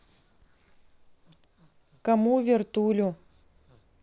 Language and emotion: Russian, neutral